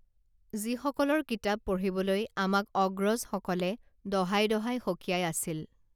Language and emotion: Assamese, neutral